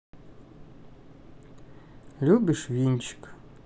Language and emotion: Russian, neutral